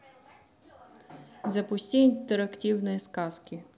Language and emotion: Russian, neutral